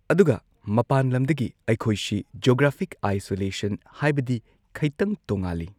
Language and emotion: Manipuri, neutral